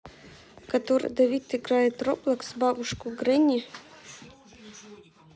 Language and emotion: Russian, neutral